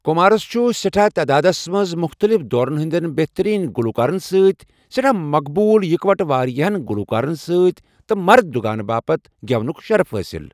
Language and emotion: Kashmiri, neutral